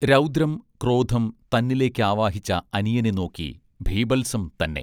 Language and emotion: Malayalam, neutral